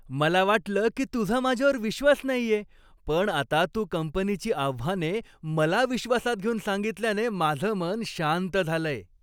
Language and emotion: Marathi, happy